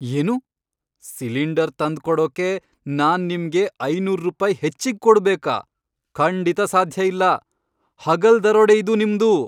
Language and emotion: Kannada, angry